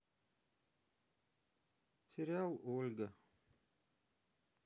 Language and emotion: Russian, sad